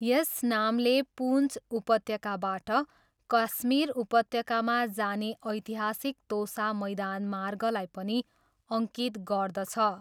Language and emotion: Nepali, neutral